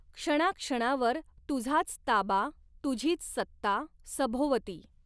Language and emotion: Marathi, neutral